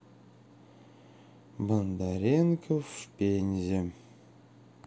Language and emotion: Russian, sad